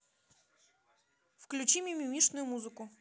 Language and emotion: Russian, neutral